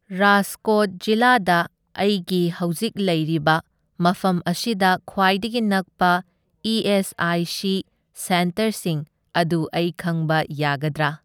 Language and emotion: Manipuri, neutral